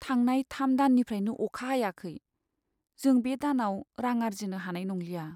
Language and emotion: Bodo, sad